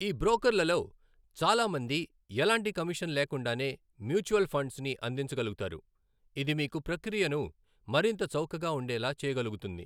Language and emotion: Telugu, neutral